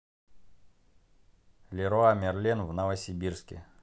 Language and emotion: Russian, neutral